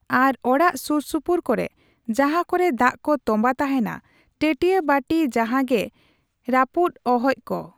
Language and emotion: Santali, neutral